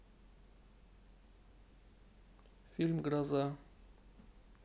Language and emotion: Russian, neutral